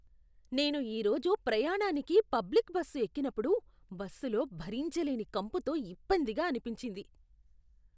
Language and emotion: Telugu, disgusted